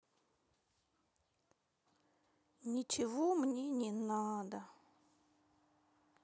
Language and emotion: Russian, sad